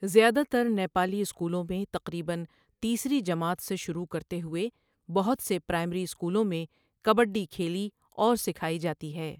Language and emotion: Urdu, neutral